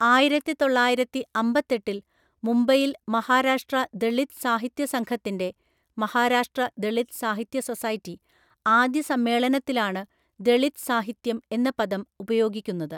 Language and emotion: Malayalam, neutral